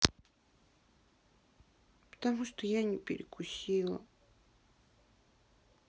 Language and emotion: Russian, sad